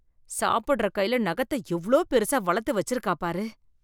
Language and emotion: Tamil, disgusted